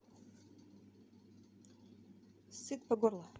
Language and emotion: Russian, neutral